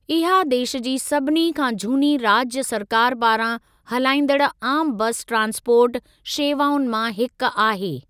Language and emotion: Sindhi, neutral